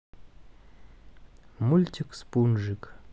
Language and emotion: Russian, neutral